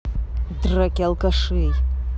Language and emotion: Russian, angry